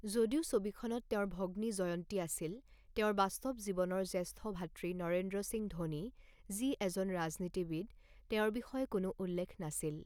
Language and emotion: Assamese, neutral